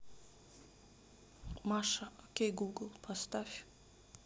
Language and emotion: Russian, sad